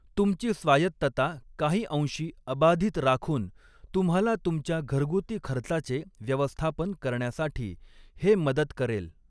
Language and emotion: Marathi, neutral